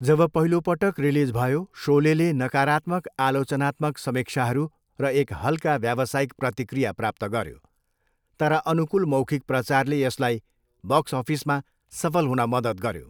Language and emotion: Nepali, neutral